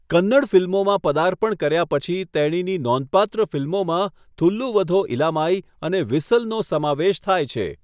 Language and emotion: Gujarati, neutral